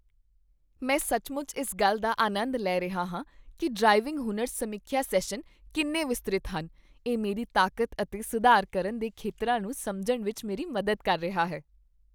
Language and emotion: Punjabi, happy